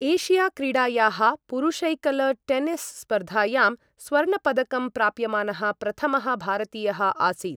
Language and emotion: Sanskrit, neutral